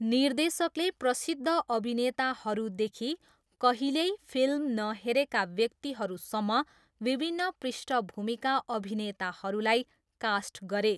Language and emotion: Nepali, neutral